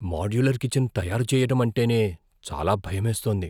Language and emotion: Telugu, fearful